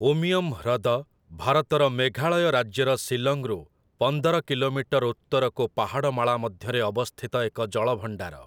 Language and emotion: Odia, neutral